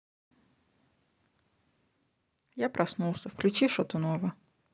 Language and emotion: Russian, neutral